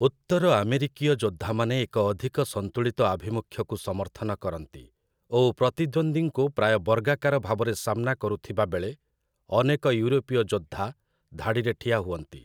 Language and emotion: Odia, neutral